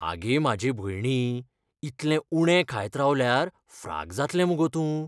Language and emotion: Goan Konkani, fearful